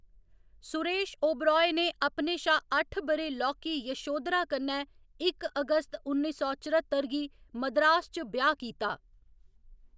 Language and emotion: Dogri, neutral